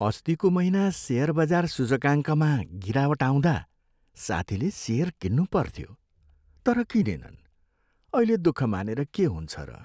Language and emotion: Nepali, sad